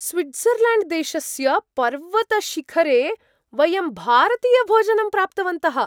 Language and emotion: Sanskrit, surprised